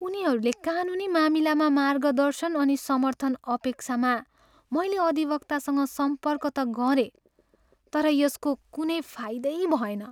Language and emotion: Nepali, sad